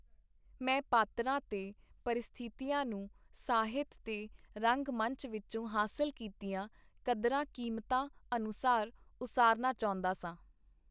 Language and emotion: Punjabi, neutral